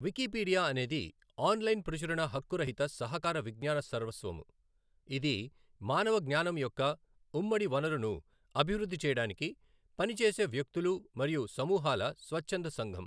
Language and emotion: Telugu, neutral